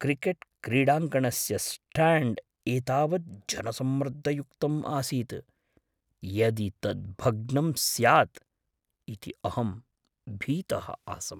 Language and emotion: Sanskrit, fearful